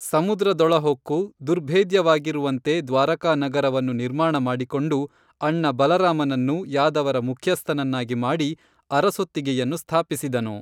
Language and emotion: Kannada, neutral